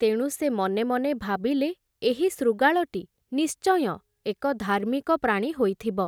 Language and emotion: Odia, neutral